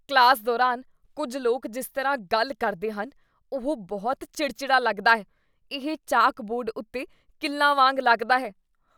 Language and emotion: Punjabi, disgusted